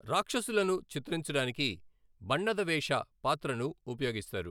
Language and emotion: Telugu, neutral